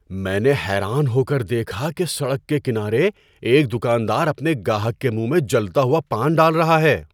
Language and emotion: Urdu, surprised